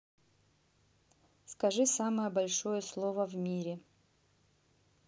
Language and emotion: Russian, neutral